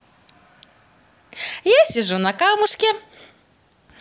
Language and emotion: Russian, positive